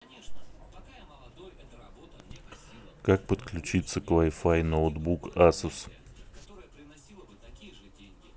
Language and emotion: Russian, neutral